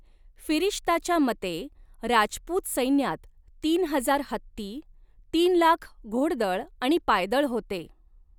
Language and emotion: Marathi, neutral